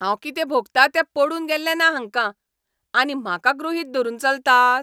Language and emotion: Goan Konkani, angry